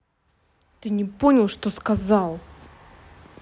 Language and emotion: Russian, angry